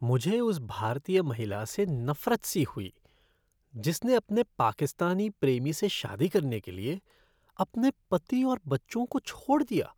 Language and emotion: Hindi, disgusted